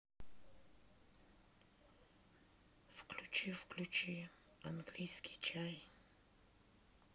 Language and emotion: Russian, sad